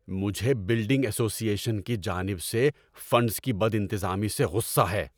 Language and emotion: Urdu, angry